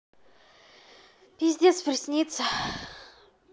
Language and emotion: Russian, angry